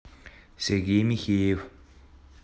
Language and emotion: Russian, neutral